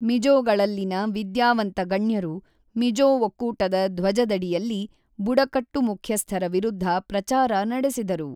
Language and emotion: Kannada, neutral